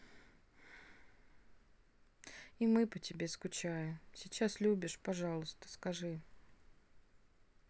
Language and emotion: Russian, sad